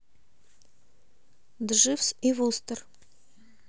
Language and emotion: Russian, neutral